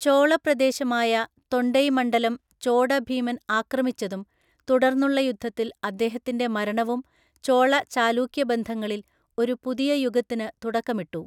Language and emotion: Malayalam, neutral